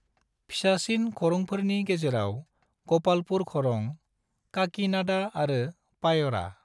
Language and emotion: Bodo, neutral